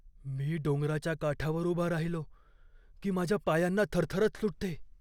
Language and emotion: Marathi, fearful